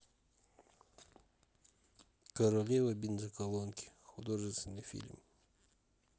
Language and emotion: Russian, neutral